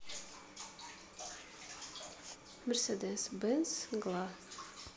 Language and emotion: Russian, neutral